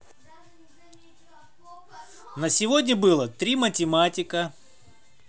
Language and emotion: Russian, neutral